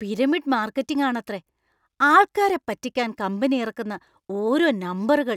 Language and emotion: Malayalam, disgusted